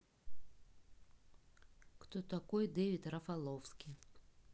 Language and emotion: Russian, neutral